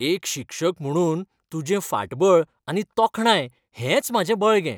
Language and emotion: Goan Konkani, happy